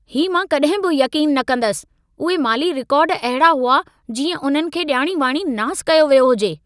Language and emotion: Sindhi, angry